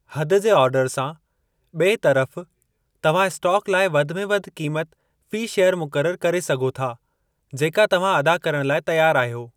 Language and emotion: Sindhi, neutral